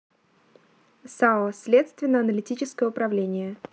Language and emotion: Russian, neutral